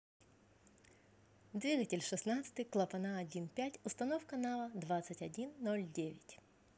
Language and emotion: Russian, positive